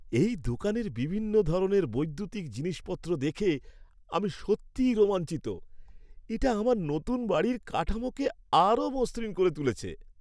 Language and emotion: Bengali, happy